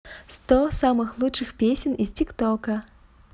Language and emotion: Russian, positive